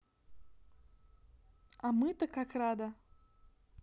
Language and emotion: Russian, positive